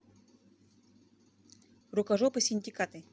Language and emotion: Russian, neutral